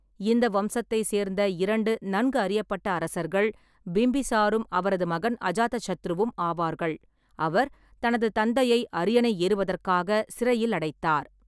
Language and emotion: Tamil, neutral